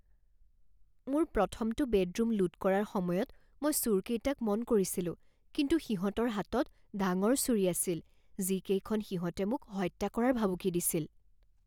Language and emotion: Assamese, fearful